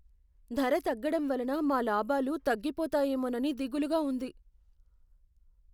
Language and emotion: Telugu, fearful